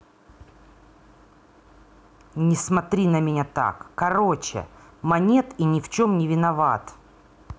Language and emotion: Russian, angry